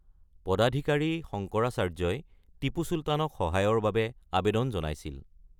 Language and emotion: Assamese, neutral